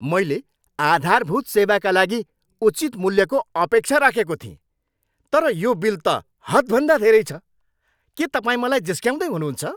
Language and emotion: Nepali, angry